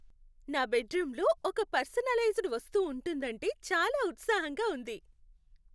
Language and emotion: Telugu, happy